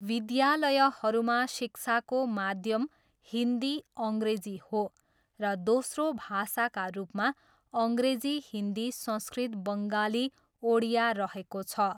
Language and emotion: Nepali, neutral